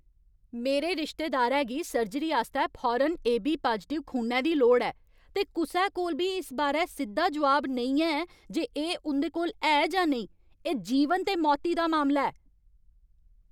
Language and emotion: Dogri, angry